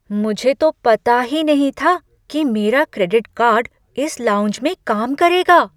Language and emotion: Hindi, surprised